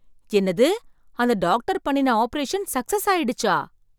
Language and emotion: Tamil, surprised